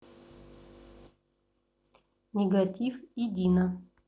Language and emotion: Russian, neutral